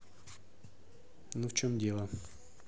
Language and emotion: Russian, neutral